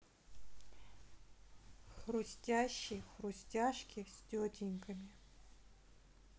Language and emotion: Russian, neutral